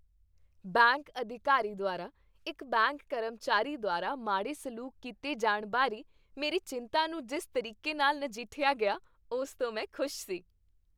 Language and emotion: Punjabi, happy